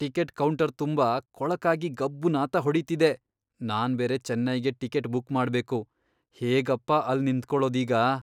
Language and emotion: Kannada, disgusted